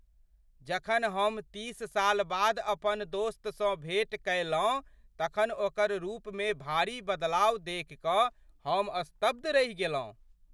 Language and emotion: Maithili, surprised